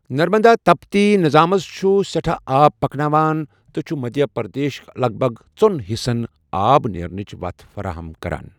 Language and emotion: Kashmiri, neutral